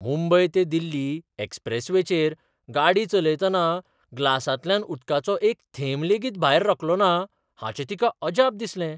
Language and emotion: Goan Konkani, surprised